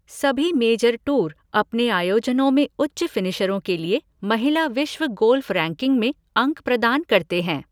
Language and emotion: Hindi, neutral